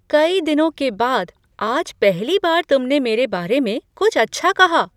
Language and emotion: Hindi, surprised